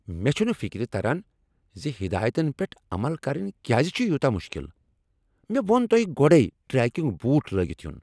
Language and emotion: Kashmiri, angry